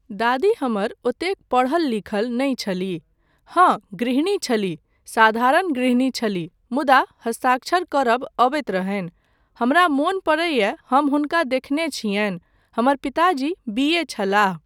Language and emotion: Maithili, neutral